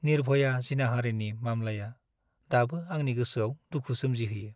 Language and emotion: Bodo, sad